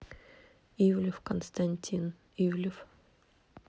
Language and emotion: Russian, neutral